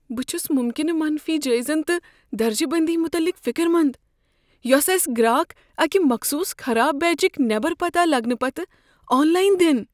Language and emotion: Kashmiri, fearful